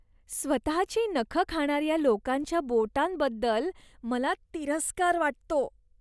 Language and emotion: Marathi, disgusted